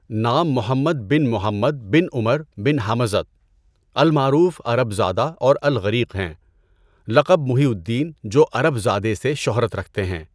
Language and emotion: Urdu, neutral